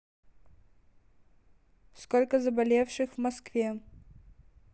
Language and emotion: Russian, neutral